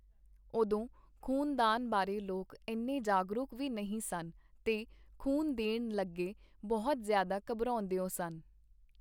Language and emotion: Punjabi, neutral